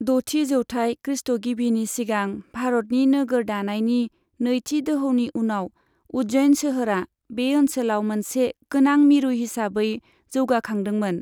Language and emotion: Bodo, neutral